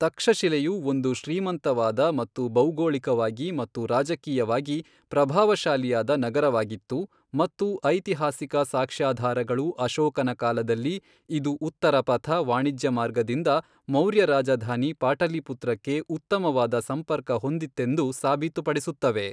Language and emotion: Kannada, neutral